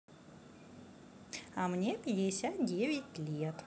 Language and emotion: Russian, positive